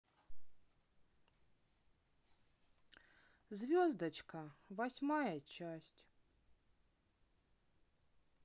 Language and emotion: Russian, neutral